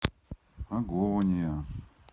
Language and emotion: Russian, neutral